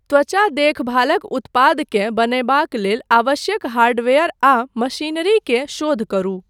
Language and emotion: Maithili, neutral